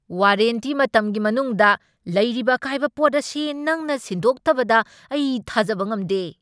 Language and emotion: Manipuri, angry